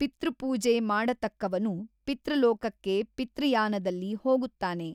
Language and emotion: Kannada, neutral